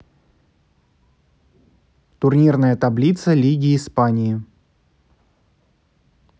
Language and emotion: Russian, neutral